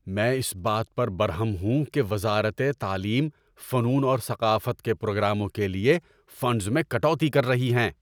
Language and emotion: Urdu, angry